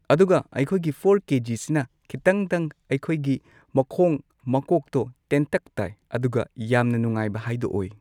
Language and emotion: Manipuri, neutral